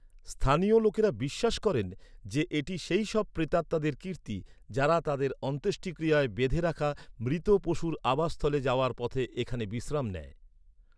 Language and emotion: Bengali, neutral